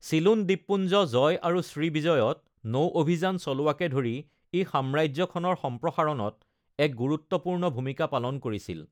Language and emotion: Assamese, neutral